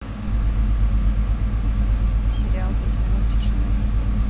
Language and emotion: Russian, neutral